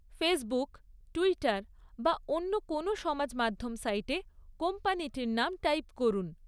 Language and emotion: Bengali, neutral